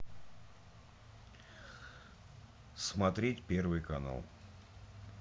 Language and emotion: Russian, neutral